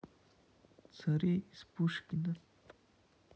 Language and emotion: Russian, neutral